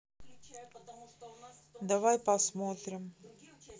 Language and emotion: Russian, neutral